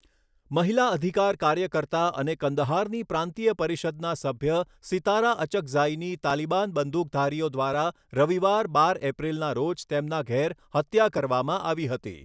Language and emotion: Gujarati, neutral